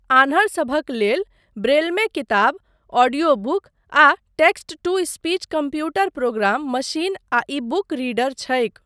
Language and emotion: Maithili, neutral